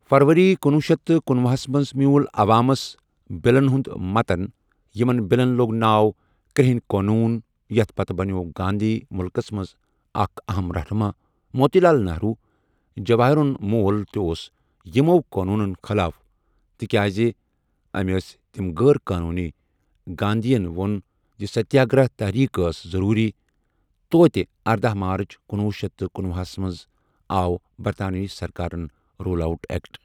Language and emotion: Kashmiri, neutral